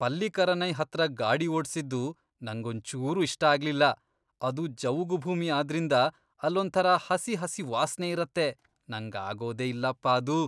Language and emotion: Kannada, disgusted